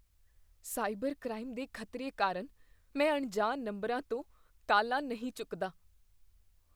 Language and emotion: Punjabi, fearful